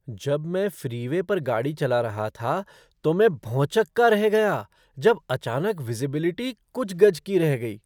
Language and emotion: Hindi, surprised